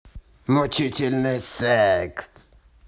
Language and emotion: Russian, angry